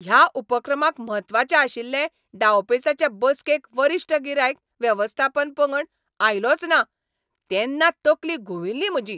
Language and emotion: Goan Konkani, angry